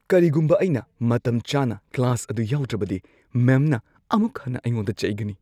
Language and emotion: Manipuri, fearful